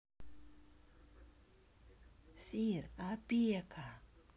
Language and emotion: Russian, neutral